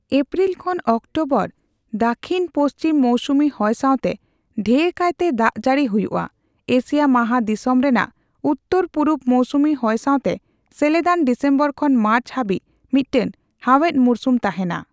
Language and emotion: Santali, neutral